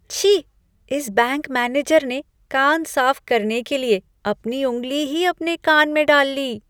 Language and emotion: Hindi, disgusted